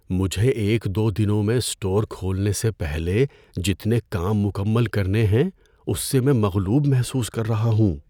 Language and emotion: Urdu, fearful